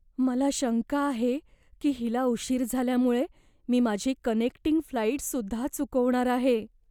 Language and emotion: Marathi, fearful